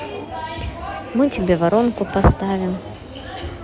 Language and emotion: Russian, neutral